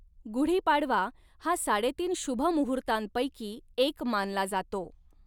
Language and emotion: Marathi, neutral